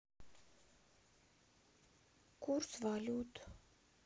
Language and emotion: Russian, sad